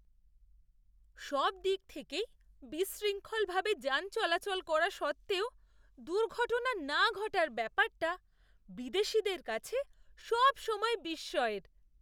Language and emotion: Bengali, surprised